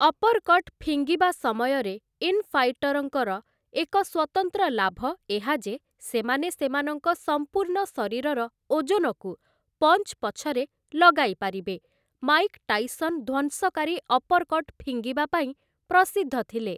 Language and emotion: Odia, neutral